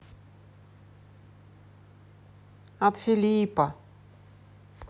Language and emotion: Russian, neutral